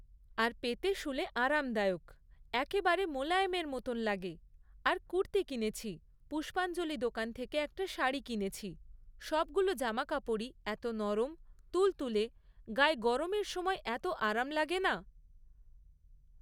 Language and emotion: Bengali, neutral